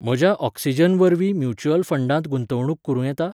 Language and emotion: Goan Konkani, neutral